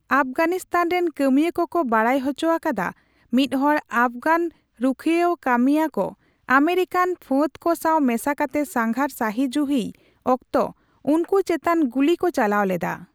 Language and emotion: Santali, neutral